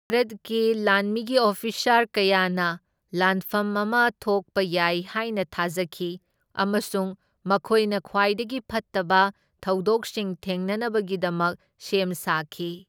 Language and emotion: Manipuri, neutral